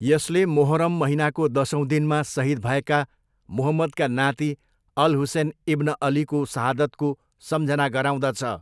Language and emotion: Nepali, neutral